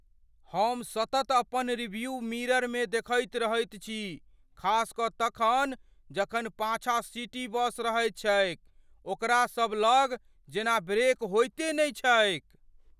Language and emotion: Maithili, fearful